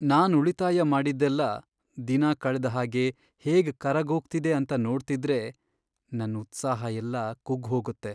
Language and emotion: Kannada, sad